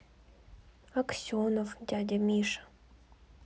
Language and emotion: Russian, sad